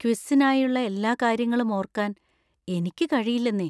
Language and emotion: Malayalam, fearful